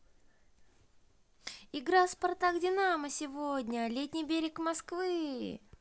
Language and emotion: Russian, positive